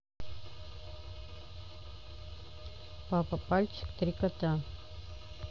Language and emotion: Russian, neutral